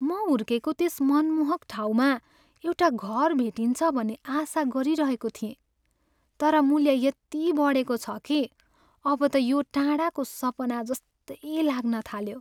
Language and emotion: Nepali, sad